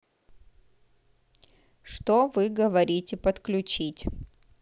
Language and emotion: Russian, neutral